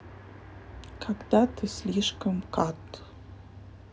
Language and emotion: Russian, neutral